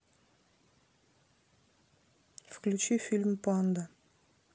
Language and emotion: Russian, neutral